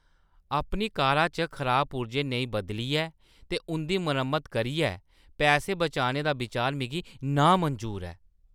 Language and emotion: Dogri, disgusted